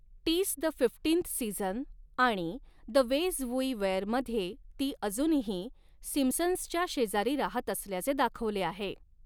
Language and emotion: Marathi, neutral